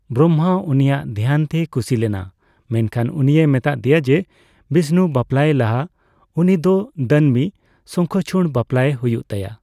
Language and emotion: Santali, neutral